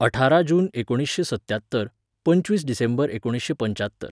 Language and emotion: Goan Konkani, neutral